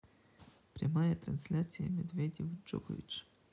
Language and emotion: Russian, neutral